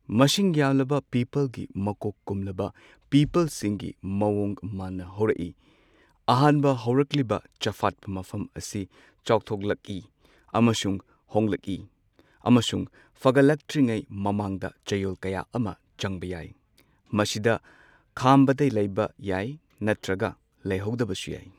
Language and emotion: Manipuri, neutral